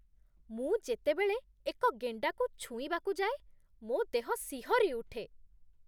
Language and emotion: Odia, disgusted